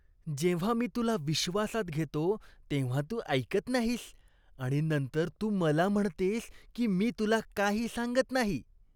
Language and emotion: Marathi, disgusted